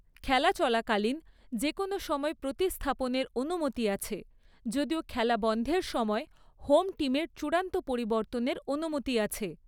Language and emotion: Bengali, neutral